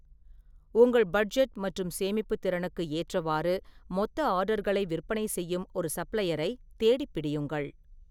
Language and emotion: Tamil, neutral